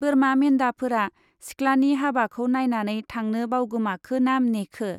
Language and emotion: Bodo, neutral